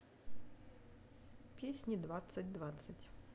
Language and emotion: Russian, neutral